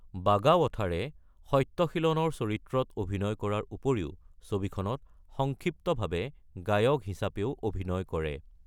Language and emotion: Assamese, neutral